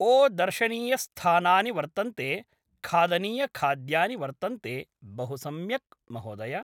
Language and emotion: Sanskrit, neutral